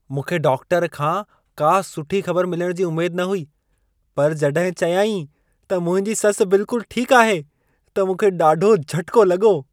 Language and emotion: Sindhi, surprised